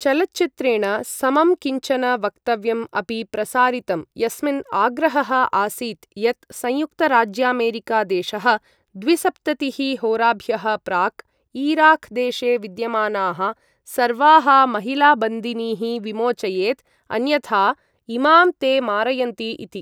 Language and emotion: Sanskrit, neutral